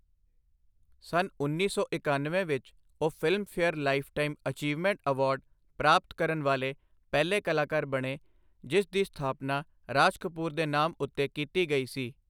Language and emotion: Punjabi, neutral